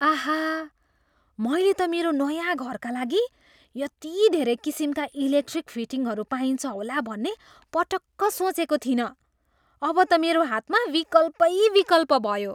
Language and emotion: Nepali, surprised